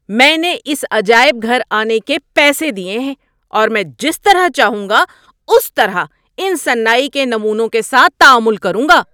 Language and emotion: Urdu, angry